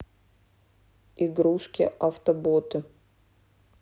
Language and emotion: Russian, neutral